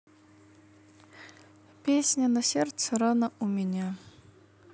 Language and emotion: Russian, sad